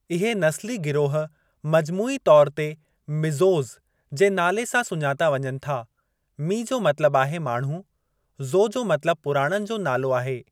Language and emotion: Sindhi, neutral